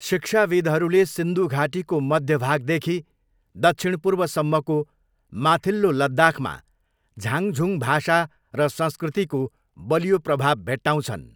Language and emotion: Nepali, neutral